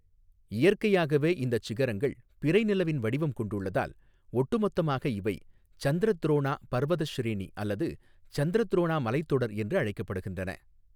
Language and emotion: Tamil, neutral